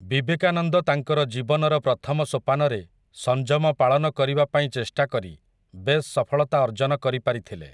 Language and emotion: Odia, neutral